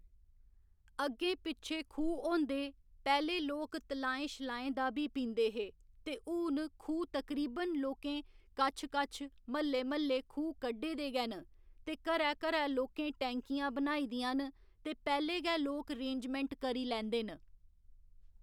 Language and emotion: Dogri, neutral